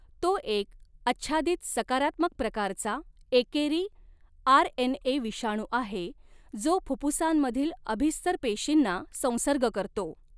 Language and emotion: Marathi, neutral